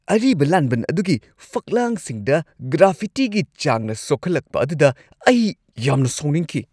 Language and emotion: Manipuri, angry